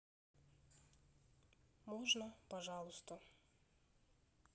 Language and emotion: Russian, neutral